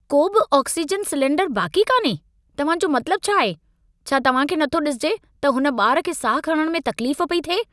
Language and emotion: Sindhi, angry